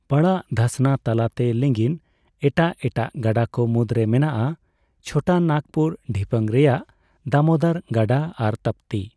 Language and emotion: Santali, neutral